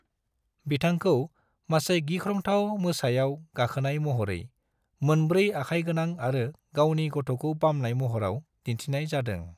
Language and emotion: Bodo, neutral